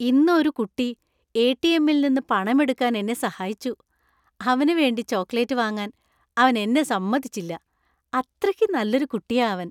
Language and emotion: Malayalam, happy